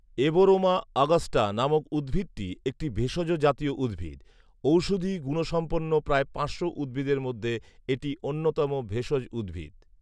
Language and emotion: Bengali, neutral